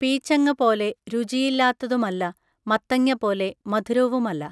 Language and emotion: Malayalam, neutral